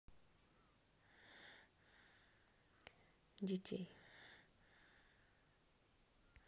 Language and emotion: Russian, sad